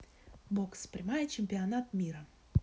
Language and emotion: Russian, neutral